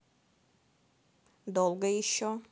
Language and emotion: Russian, angry